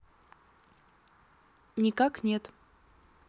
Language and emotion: Russian, neutral